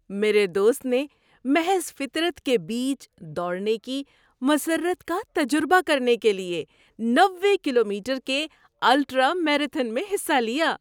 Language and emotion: Urdu, happy